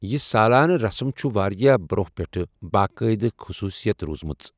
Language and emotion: Kashmiri, neutral